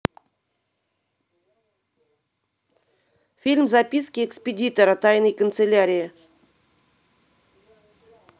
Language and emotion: Russian, neutral